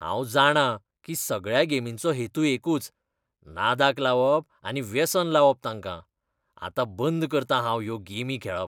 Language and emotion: Goan Konkani, disgusted